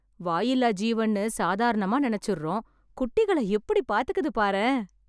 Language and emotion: Tamil, happy